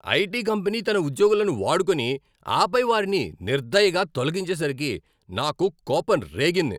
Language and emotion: Telugu, angry